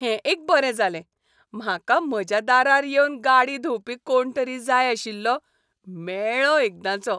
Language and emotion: Goan Konkani, happy